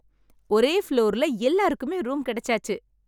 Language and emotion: Tamil, happy